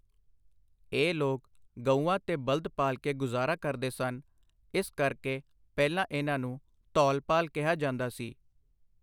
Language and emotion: Punjabi, neutral